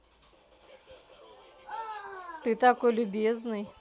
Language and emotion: Russian, positive